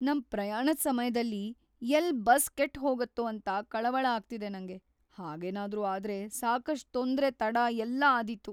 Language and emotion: Kannada, fearful